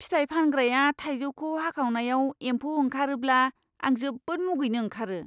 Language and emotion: Bodo, disgusted